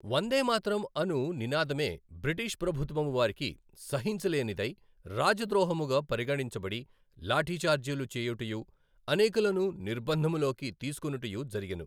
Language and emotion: Telugu, neutral